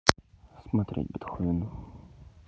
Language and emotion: Russian, neutral